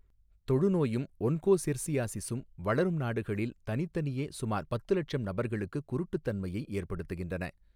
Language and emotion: Tamil, neutral